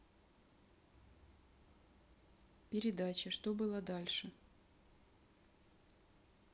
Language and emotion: Russian, neutral